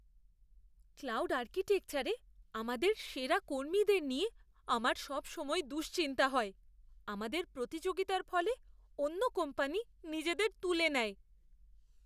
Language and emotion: Bengali, fearful